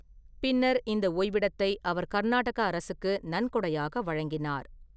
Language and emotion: Tamil, neutral